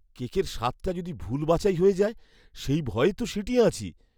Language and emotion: Bengali, fearful